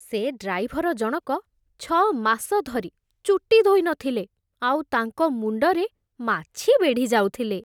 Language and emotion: Odia, disgusted